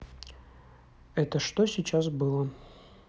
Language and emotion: Russian, neutral